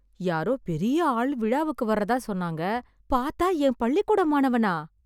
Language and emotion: Tamil, surprised